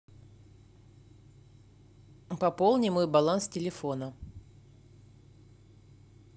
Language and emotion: Russian, neutral